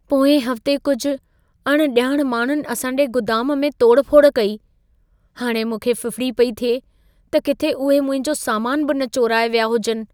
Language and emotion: Sindhi, fearful